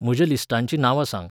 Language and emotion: Goan Konkani, neutral